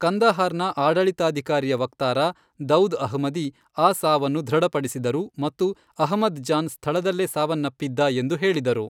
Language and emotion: Kannada, neutral